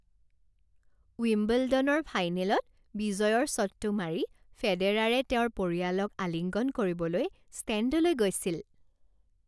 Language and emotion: Assamese, happy